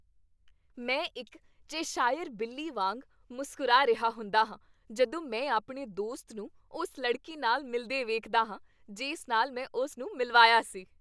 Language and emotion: Punjabi, happy